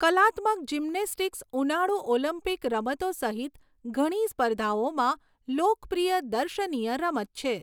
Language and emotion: Gujarati, neutral